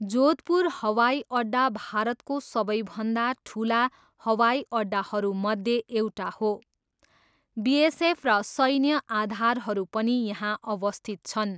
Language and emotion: Nepali, neutral